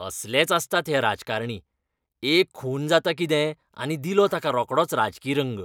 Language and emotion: Goan Konkani, disgusted